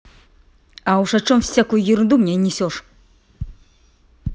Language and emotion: Russian, angry